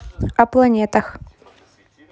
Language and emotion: Russian, neutral